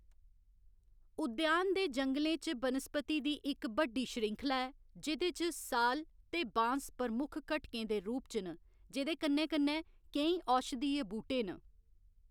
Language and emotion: Dogri, neutral